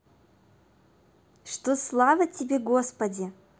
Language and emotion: Russian, positive